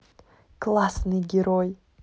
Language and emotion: Russian, positive